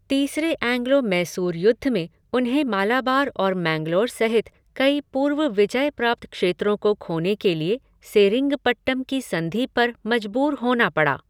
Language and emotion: Hindi, neutral